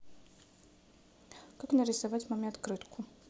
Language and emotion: Russian, neutral